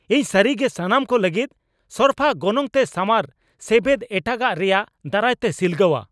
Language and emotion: Santali, angry